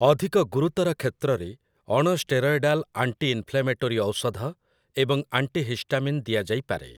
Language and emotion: Odia, neutral